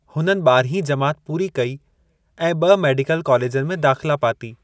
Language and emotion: Sindhi, neutral